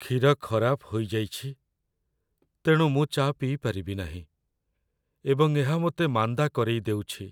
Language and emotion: Odia, sad